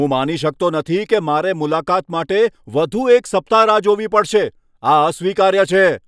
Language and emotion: Gujarati, angry